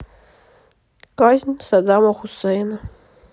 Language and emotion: Russian, neutral